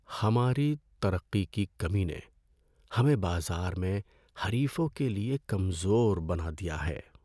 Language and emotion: Urdu, sad